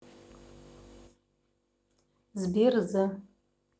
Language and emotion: Russian, neutral